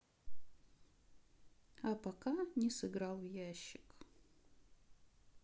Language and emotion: Russian, sad